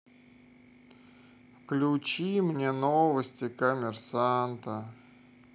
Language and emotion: Russian, sad